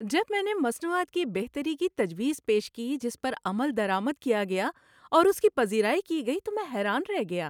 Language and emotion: Urdu, happy